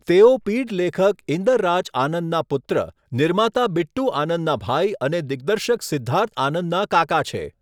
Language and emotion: Gujarati, neutral